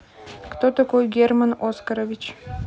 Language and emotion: Russian, neutral